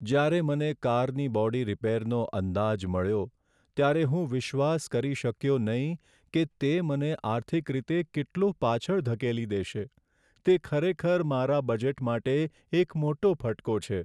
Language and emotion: Gujarati, sad